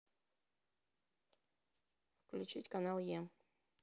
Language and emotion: Russian, neutral